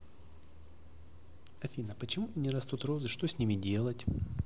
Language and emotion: Russian, neutral